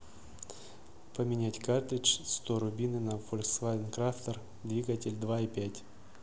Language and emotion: Russian, neutral